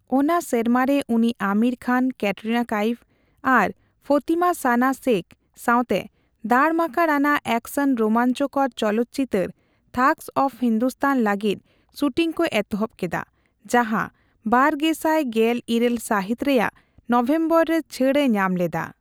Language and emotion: Santali, neutral